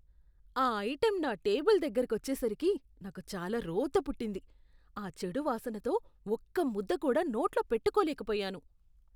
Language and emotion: Telugu, disgusted